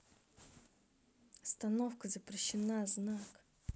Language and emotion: Russian, angry